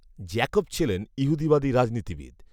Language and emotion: Bengali, neutral